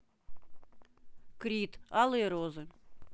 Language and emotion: Russian, neutral